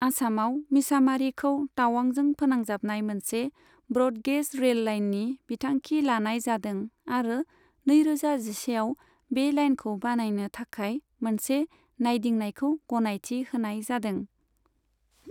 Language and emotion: Bodo, neutral